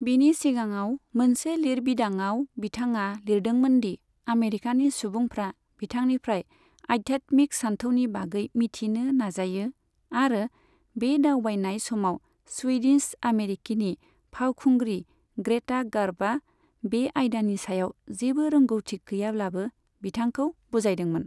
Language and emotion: Bodo, neutral